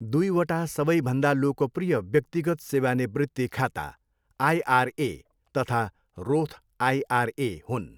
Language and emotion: Nepali, neutral